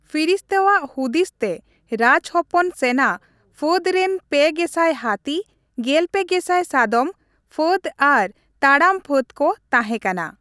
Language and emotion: Santali, neutral